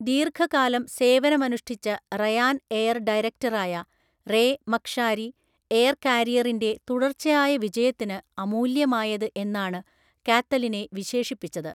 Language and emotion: Malayalam, neutral